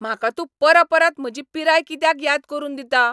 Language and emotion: Goan Konkani, angry